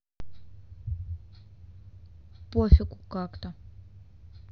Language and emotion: Russian, neutral